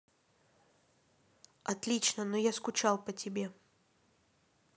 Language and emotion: Russian, neutral